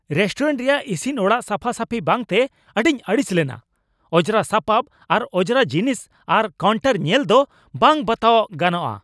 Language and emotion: Santali, angry